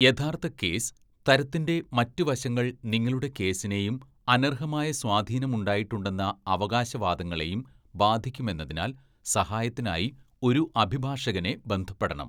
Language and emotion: Malayalam, neutral